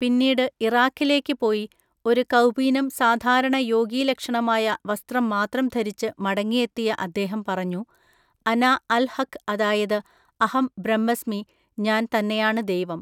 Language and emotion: Malayalam, neutral